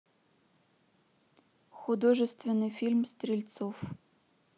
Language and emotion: Russian, neutral